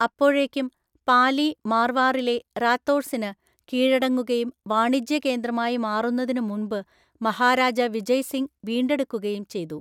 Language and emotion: Malayalam, neutral